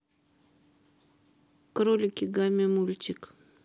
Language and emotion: Russian, neutral